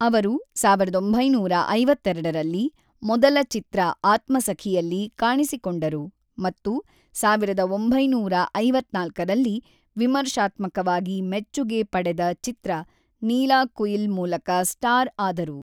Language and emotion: Kannada, neutral